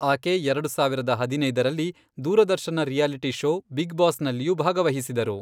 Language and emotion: Kannada, neutral